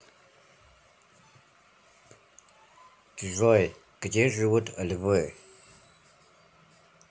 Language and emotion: Russian, neutral